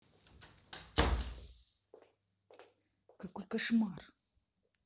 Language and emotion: Russian, angry